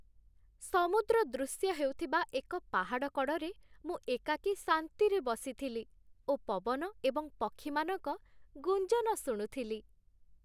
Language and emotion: Odia, happy